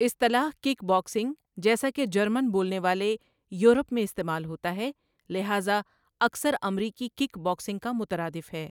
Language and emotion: Urdu, neutral